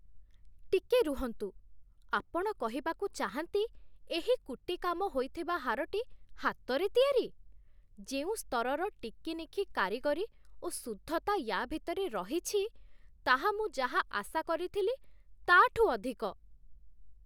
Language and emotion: Odia, surprised